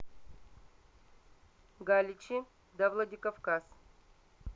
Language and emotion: Russian, neutral